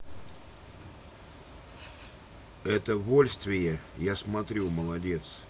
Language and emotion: Russian, neutral